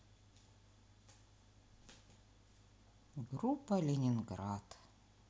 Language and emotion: Russian, sad